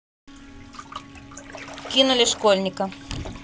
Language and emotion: Russian, neutral